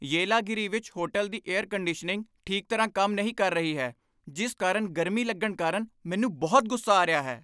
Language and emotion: Punjabi, angry